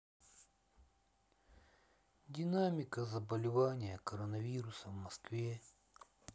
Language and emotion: Russian, sad